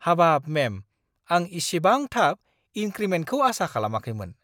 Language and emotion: Bodo, surprised